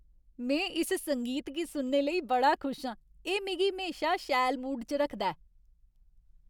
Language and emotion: Dogri, happy